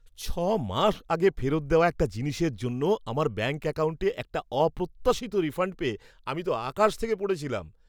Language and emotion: Bengali, surprised